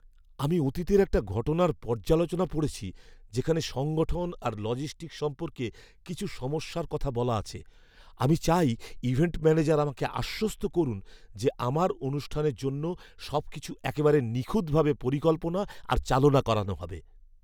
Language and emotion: Bengali, fearful